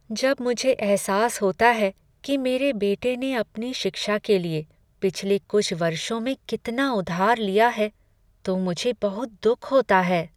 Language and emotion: Hindi, sad